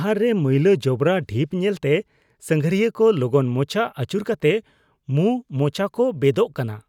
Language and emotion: Santali, disgusted